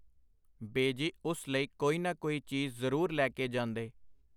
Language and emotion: Punjabi, neutral